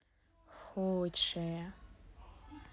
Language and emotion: Russian, neutral